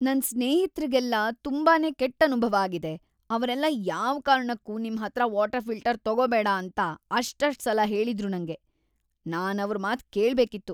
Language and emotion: Kannada, disgusted